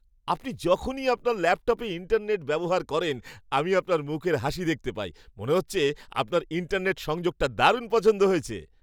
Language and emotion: Bengali, happy